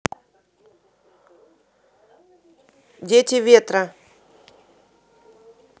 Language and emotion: Russian, neutral